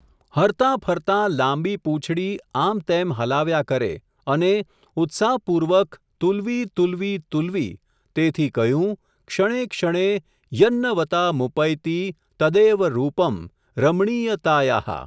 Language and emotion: Gujarati, neutral